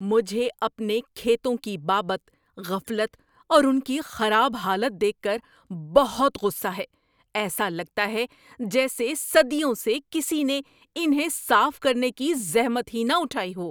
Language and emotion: Urdu, angry